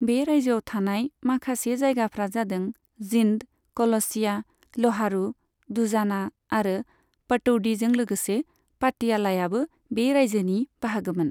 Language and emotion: Bodo, neutral